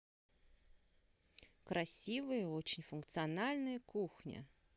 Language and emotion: Russian, neutral